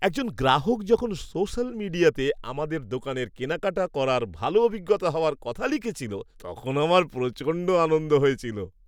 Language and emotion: Bengali, happy